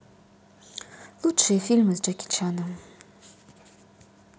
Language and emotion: Russian, neutral